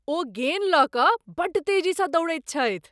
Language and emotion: Maithili, surprised